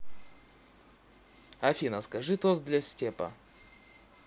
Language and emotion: Russian, neutral